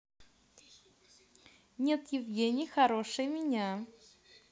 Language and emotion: Russian, positive